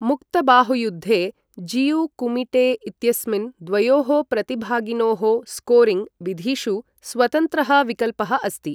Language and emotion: Sanskrit, neutral